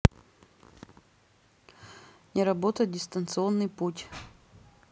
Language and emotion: Russian, neutral